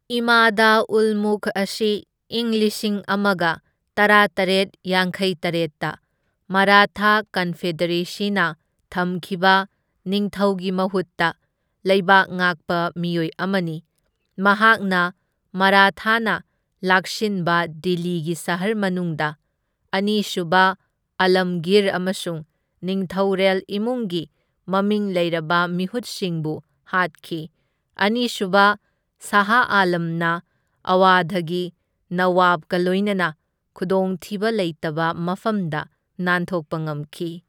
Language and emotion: Manipuri, neutral